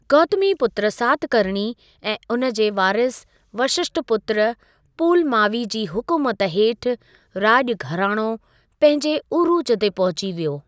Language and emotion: Sindhi, neutral